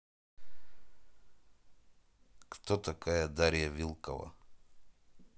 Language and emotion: Russian, neutral